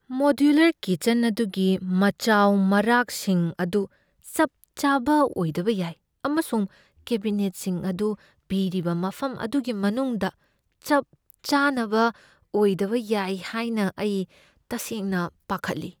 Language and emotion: Manipuri, fearful